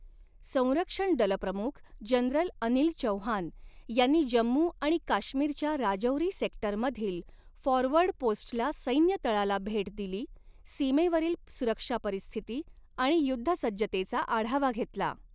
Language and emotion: Marathi, neutral